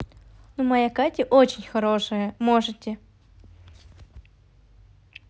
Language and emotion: Russian, positive